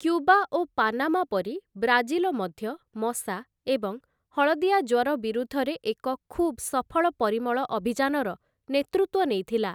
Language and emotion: Odia, neutral